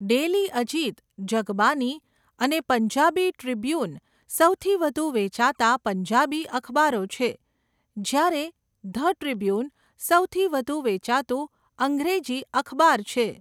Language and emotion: Gujarati, neutral